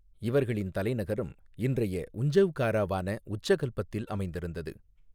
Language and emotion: Tamil, neutral